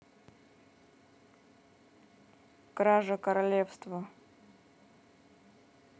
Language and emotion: Russian, neutral